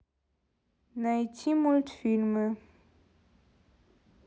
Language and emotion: Russian, neutral